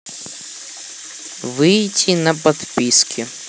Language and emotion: Russian, neutral